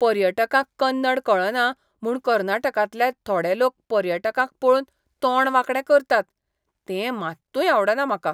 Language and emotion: Goan Konkani, disgusted